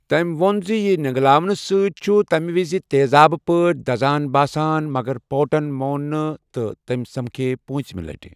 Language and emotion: Kashmiri, neutral